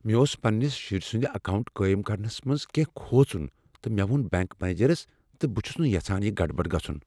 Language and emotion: Kashmiri, fearful